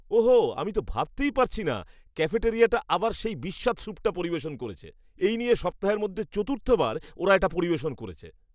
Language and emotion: Bengali, disgusted